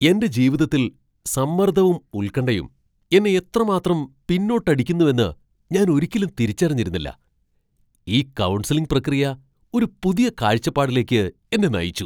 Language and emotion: Malayalam, surprised